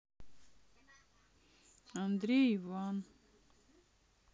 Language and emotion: Russian, sad